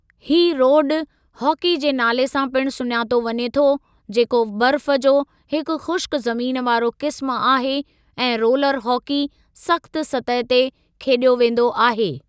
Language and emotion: Sindhi, neutral